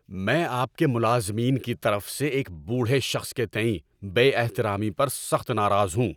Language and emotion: Urdu, angry